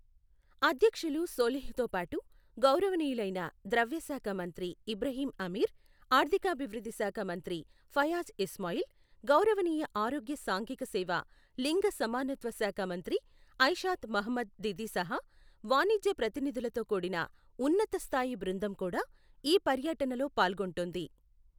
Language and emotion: Telugu, neutral